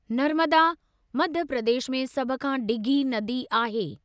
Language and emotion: Sindhi, neutral